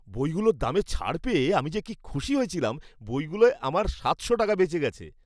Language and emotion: Bengali, happy